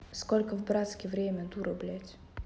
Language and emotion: Russian, neutral